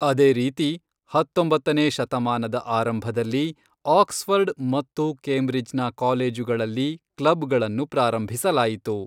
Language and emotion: Kannada, neutral